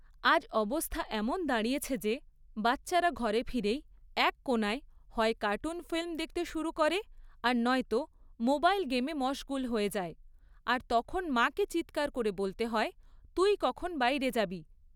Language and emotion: Bengali, neutral